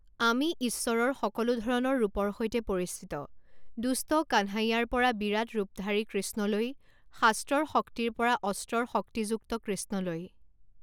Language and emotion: Assamese, neutral